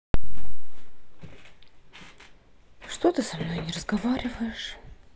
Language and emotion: Russian, sad